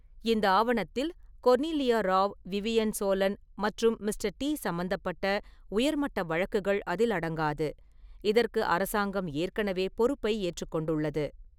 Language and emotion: Tamil, neutral